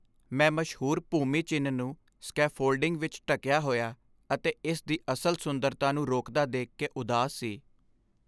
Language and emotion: Punjabi, sad